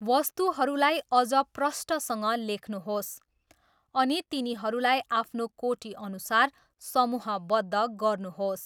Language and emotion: Nepali, neutral